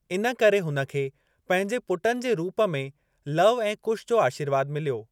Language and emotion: Sindhi, neutral